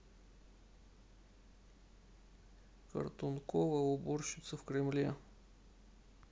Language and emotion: Russian, neutral